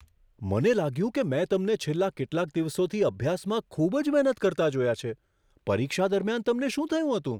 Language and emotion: Gujarati, surprised